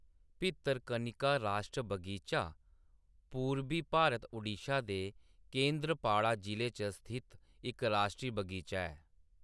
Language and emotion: Dogri, neutral